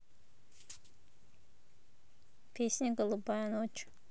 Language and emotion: Russian, neutral